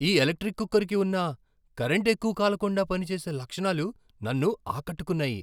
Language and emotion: Telugu, surprised